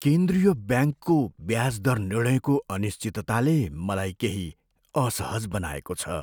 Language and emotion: Nepali, fearful